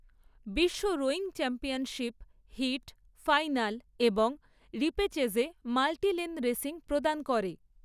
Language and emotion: Bengali, neutral